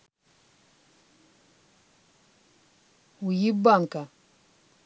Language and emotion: Russian, angry